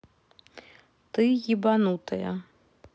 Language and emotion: Russian, neutral